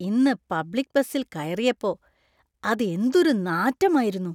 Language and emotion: Malayalam, disgusted